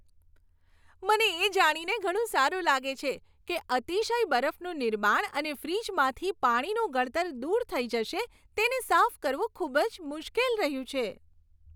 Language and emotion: Gujarati, happy